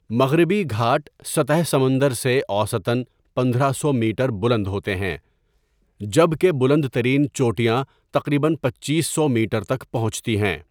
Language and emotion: Urdu, neutral